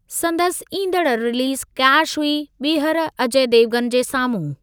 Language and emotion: Sindhi, neutral